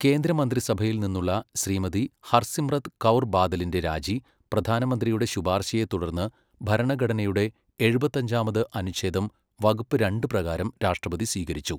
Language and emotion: Malayalam, neutral